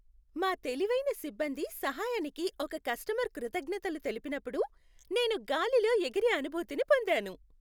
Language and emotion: Telugu, happy